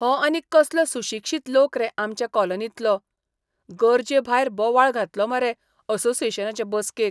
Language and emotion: Goan Konkani, disgusted